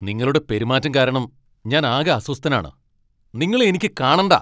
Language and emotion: Malayalam, angry